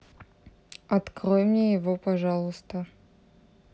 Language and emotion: Russian, neutral